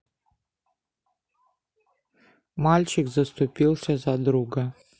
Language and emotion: Russian, neutral